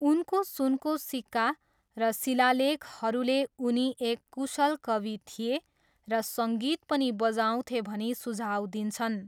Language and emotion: Nepali, neutral